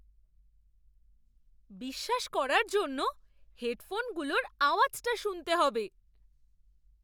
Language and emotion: Bengali, surprised